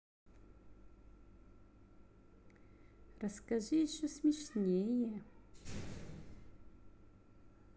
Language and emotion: Russian, neutral